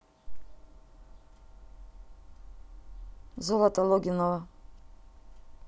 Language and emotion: Russian, neutral